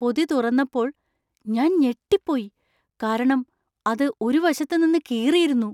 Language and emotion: Malayalam, surprised